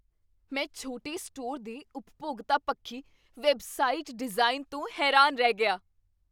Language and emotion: Punjabi, surprised